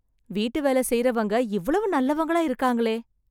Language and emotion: Tamil, surprised